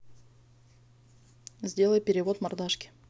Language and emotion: Russian, neutral